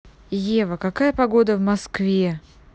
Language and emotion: Russian, neutral